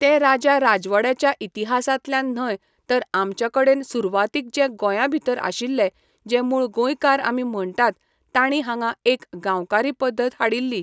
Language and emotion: Goan Konkani, neutral